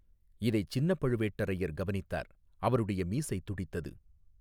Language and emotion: Tamil, neutral